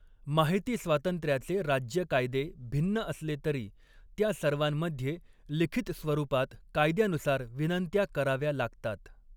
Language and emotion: Marathi, neutral